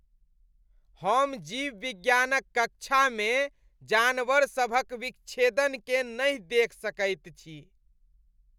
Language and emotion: Maithili, disgusted